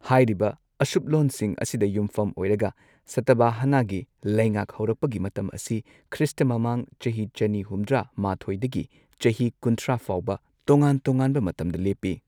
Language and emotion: Manipuri, neutral